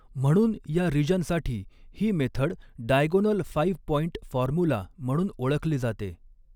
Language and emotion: Marathi, neutral